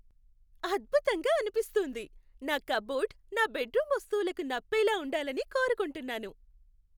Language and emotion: Telugu, happy